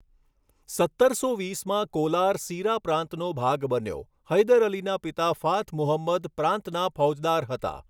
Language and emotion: Gujarati, neutral